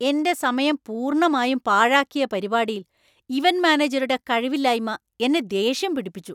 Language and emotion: Malayalam, angry